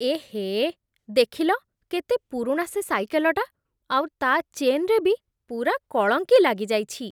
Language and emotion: Odia, disgusted